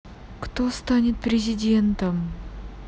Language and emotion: Russian, sad